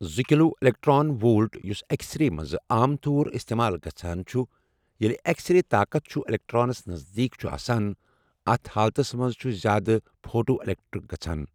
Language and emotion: Kashmiri, neutral